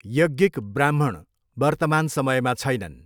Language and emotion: Nepali, neutral